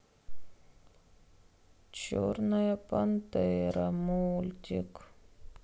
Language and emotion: Russian, sad